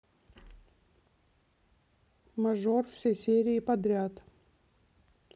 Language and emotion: Russian, neutral